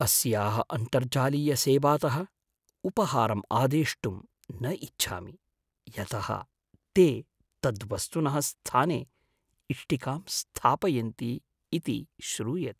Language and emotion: Sanskrit, fearful